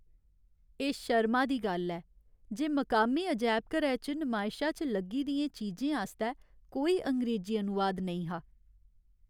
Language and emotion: Dogri, sad